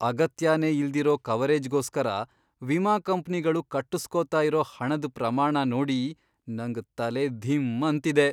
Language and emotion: Kannada, surprised